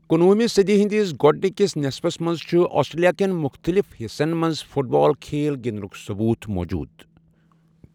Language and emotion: Kashmiri, neutral